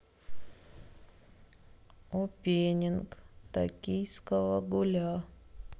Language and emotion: Russian, sad